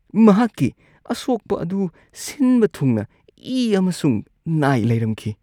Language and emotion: Manipuri, disgusted